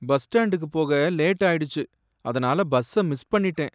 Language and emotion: Tamil, sad